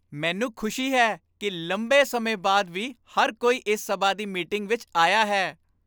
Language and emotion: Punjabi, happy